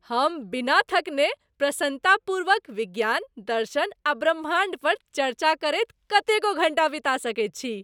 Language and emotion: Maithili, happy